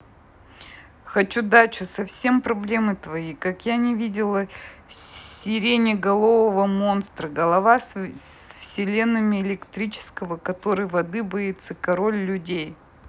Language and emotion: Russian, neutral